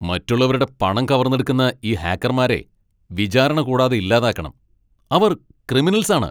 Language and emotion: Malayalam, angry